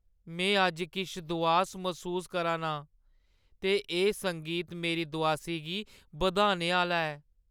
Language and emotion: Dogri, sad